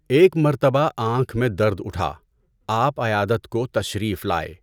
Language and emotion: Urdu, neutral